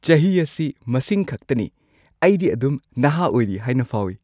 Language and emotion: Manipuri, happy